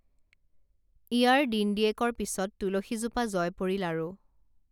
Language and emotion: Assamese, neutral